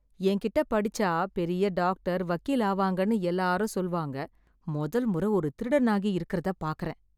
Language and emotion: Tamil, disgusted